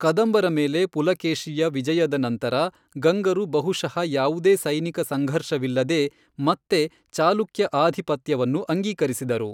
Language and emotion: Kannada, neutral